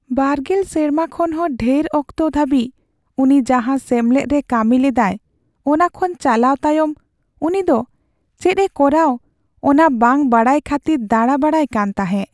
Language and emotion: Santali, sad